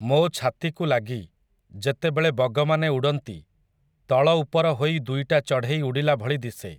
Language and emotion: Odia, neutral